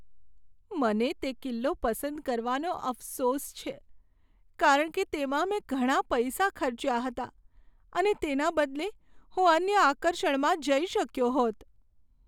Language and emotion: Gujarati, sad